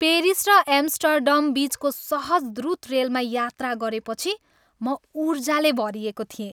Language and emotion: Nepali, happy